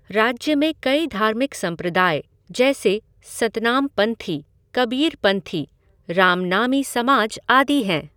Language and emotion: Hindi, neutral